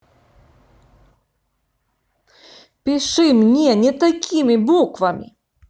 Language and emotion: Russian, angry